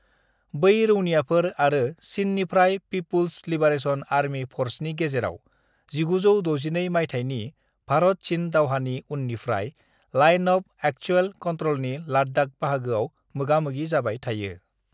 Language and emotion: Bodo, neutral